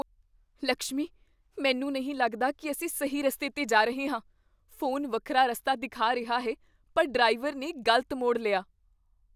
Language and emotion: Punjabi, fearful